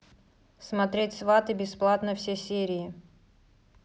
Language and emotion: Russian, neutral